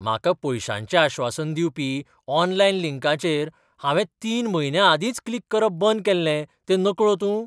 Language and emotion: Goan Konkani, surprised